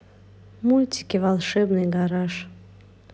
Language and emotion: Russian, neutral